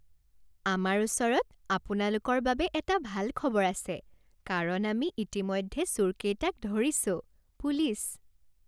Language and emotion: Assamese, happy